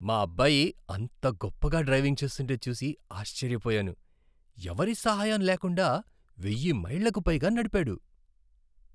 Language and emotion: Telugu, surprised